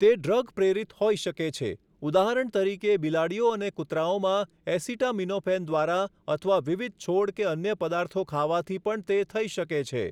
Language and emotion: Gujarati, neutral